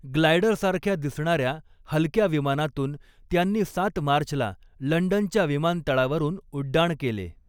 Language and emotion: Marathi, neutral